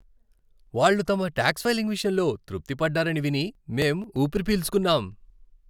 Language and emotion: Telugu, happy